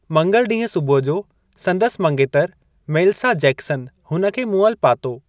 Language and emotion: Sindhi, neutral